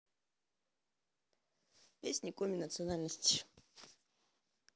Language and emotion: Russian, neutral